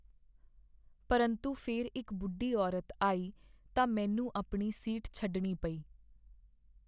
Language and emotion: Punjabi, sad